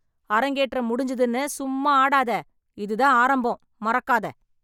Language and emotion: Tamil, angry